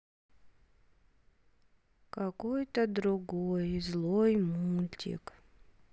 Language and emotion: Russian, sad